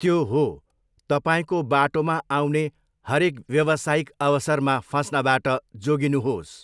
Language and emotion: Nepali, neutral